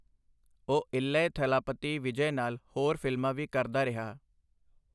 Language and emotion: Punjabi, neutral